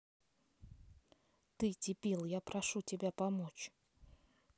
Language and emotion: Russian, angry